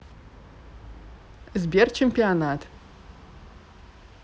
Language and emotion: Russian, neutral